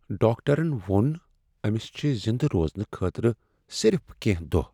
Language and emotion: Kashmiri, sad